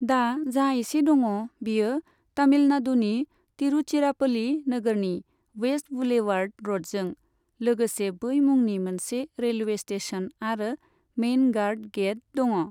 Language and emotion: Bodo, neutral